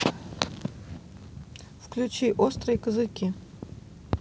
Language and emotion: Russian, neutral